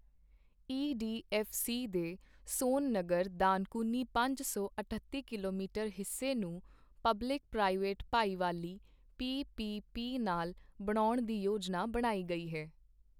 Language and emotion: Punjabi, neutral